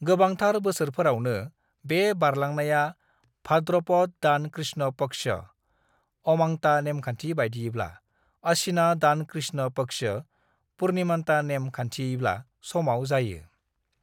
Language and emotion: Bodo, neutral